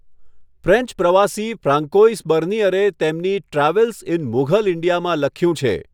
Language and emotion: Gujarati, neutral